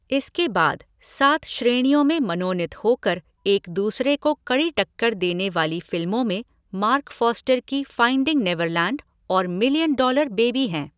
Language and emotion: Hindi, neutral